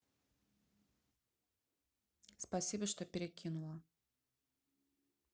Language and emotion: Russian, neutral